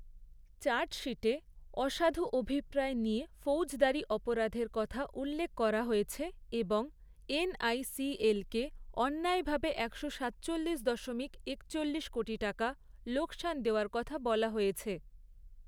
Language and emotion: Bengali, neutral